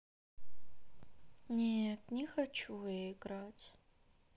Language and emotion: Russian, sad